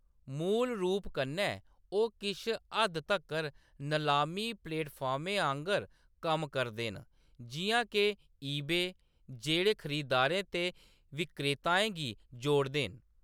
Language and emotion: Dogri, neutral